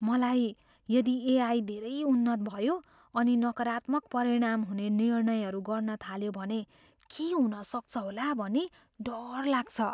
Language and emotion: Nepali, fearful